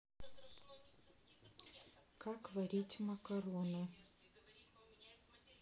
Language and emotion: Russian, neutral